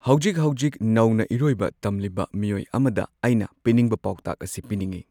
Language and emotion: Manipuri, neutral